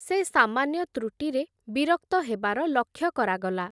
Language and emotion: Odia, neutral